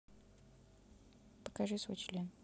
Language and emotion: Russian, neutral